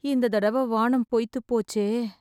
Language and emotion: Tamil, sad